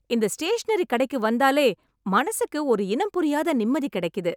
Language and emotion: Tamil, happy